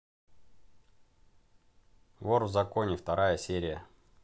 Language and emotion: Russian, positive